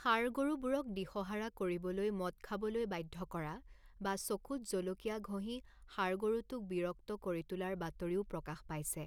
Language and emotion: Assamese, neutral